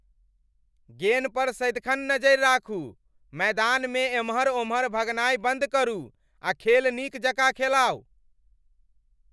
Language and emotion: Maithili, angry